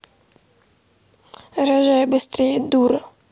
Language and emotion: Russian, angry